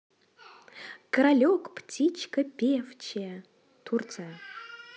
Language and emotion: Russian, positive